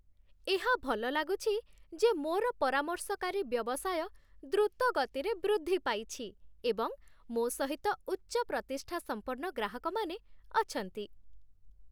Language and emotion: Odia, happy